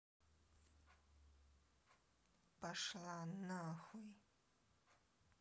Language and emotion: Russian, angry